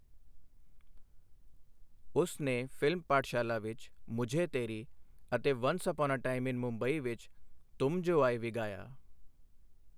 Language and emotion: Punjabi, neutral